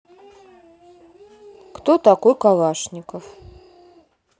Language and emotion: Russian, neutral